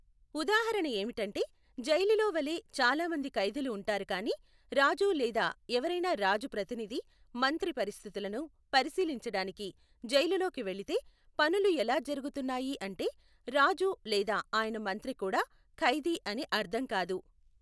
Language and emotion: Telugu, neutral